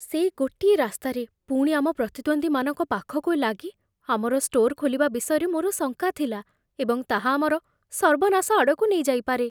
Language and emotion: Odia, fearful